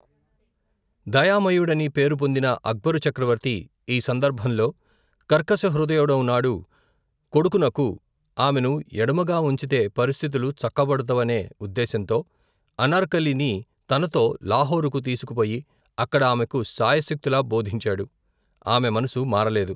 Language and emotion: Telugu, neutral